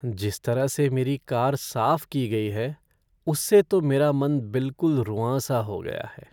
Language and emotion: Hindi, sad